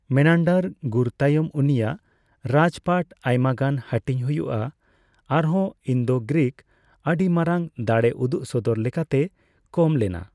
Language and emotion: Santali, neutral